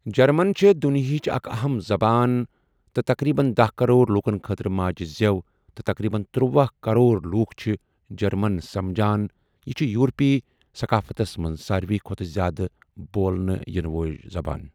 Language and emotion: Kashmiri, neutral